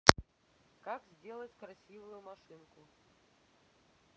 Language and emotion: Russian, neutral